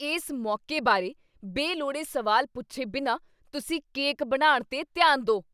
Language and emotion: Punjabi, angry